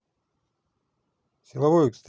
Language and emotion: Russian, neutral